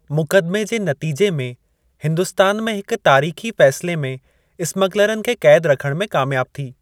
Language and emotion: Sindhi, neutral